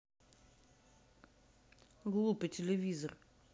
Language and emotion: Russian, angry